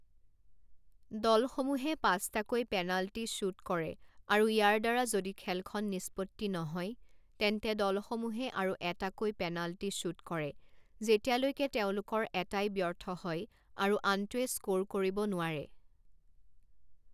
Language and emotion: Assamese, neutral